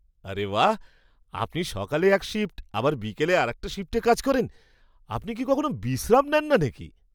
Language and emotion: Bengali, surprised